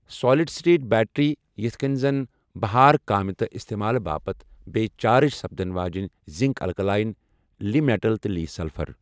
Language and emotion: Kashmiri, neutral